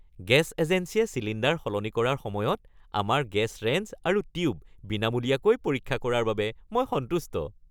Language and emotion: Assamese, happy